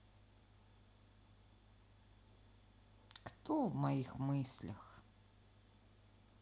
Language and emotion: Russian, neutral